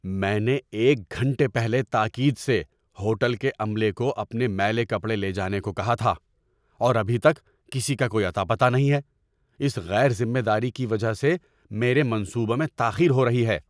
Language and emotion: Urdu, angry